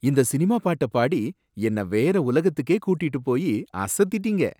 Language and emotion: Tamil, surprised